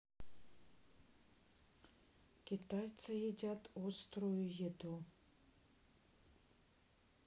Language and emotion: Russian, neutral